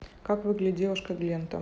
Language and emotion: Russian, neutral